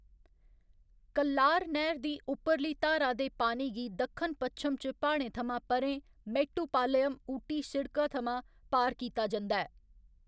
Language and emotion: Dogri, neutral